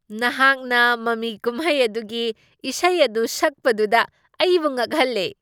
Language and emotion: Manipuri, surprised